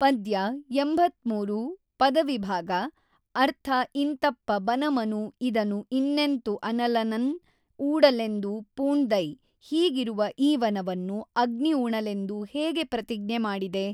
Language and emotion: Kannada, neutral